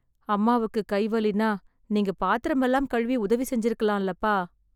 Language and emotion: Tamil, sad